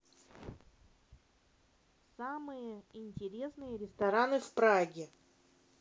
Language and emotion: Russian, neutral